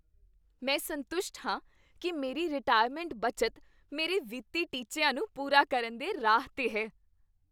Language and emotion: Punjabi, happy